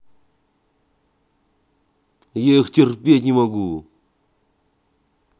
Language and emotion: Russian, angry